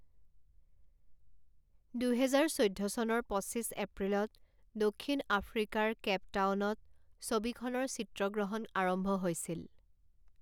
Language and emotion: Assamese, neutral